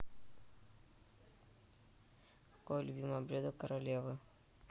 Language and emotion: Russian, neutral